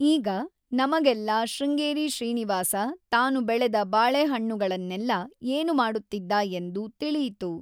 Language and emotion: Kannada, neutral